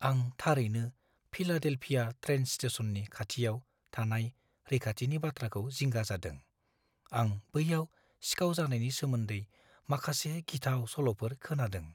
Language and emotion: Bodo, fearful